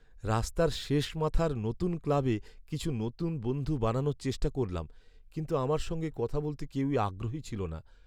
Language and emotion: Bengali, sad